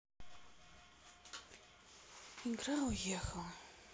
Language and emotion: Russian, sad